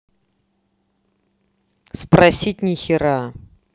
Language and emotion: Russian, angry